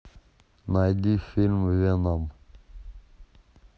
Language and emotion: Russian, neutral